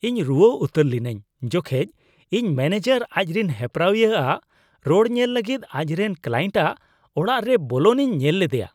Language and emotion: Santali, disgusted